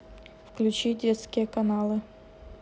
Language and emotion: Russian, neutral